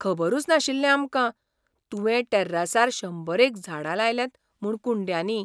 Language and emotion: Goan Konkani, surprised